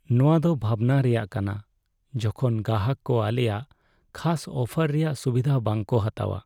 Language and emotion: Santali, sad